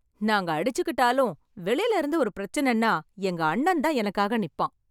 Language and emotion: Tamil, happy